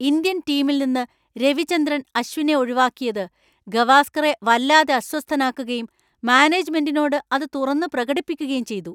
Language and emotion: Malayalam, angry